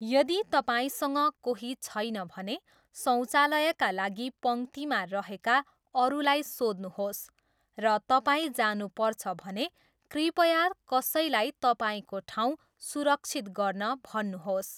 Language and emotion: Nepali, neutral